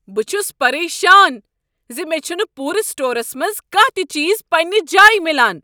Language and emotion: Kashmiri, angry